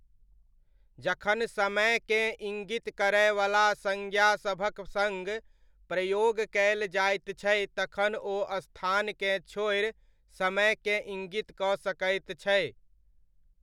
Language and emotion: Maithili, neutral